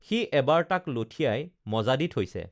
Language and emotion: Assamese, neutral